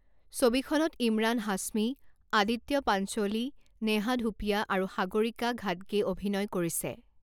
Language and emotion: Assamese, neutral